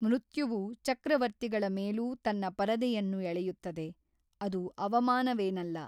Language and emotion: Kannada, neutral